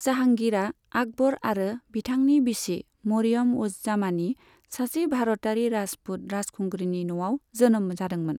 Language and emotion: Bodo, neutral